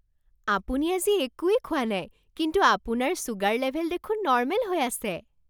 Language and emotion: Assamese, surprised